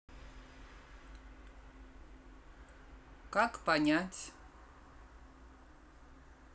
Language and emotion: Russian, neutral